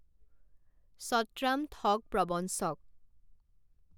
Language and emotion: Assamese, neutral